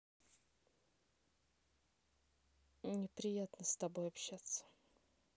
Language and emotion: Russian, neutral